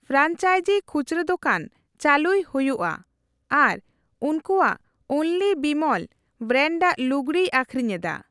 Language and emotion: Santali, neutral